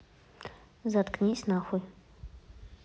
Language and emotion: Russian, angry